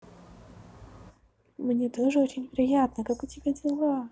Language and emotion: Russian, positive